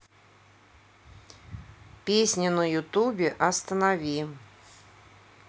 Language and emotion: Russian, neutral